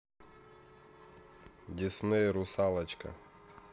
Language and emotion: Russian, neutral